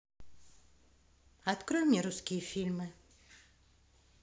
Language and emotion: Russian, neutral